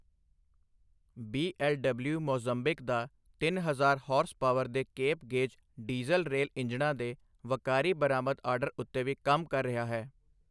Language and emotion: Punjabi, neutral